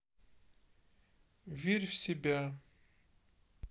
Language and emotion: Russian, sad